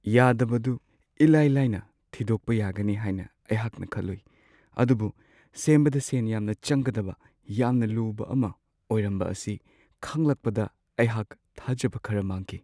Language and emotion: Manipuri, sad